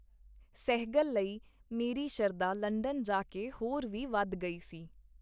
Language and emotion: Punjabi, neutral